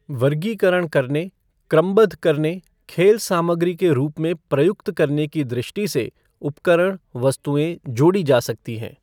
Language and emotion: Hindi, neutral